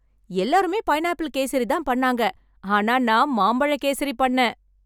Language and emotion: Tamil, happy